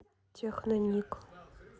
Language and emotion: Russian, neutral